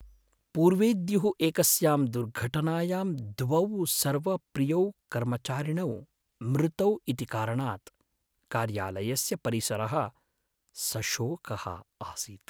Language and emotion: Sanskrit, sad